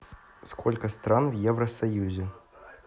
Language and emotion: Russian, neutral